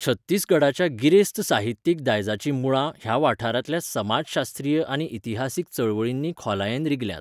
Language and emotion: Goan Konkani, neutral